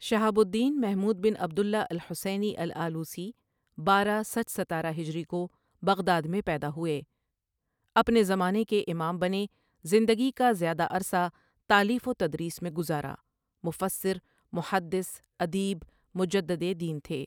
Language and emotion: Urdu, neutral